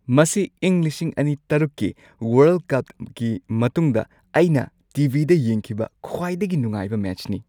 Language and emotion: Manipuri, happy